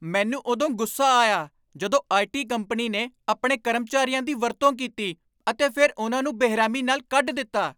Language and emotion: Punjabi, angry